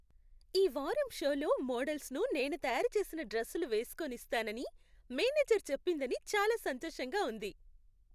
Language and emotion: Telugu, happy